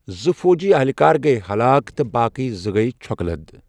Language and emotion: Kashmiri, neutral